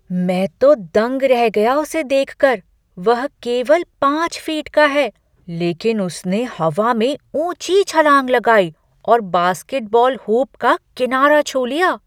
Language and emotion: Hindi, surprised